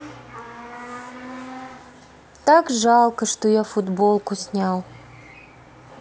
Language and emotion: Russian, sad